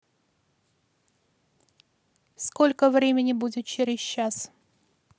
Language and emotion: Russian, neutral